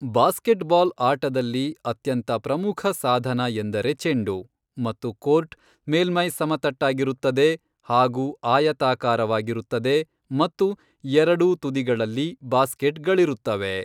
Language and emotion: Kannada, neutral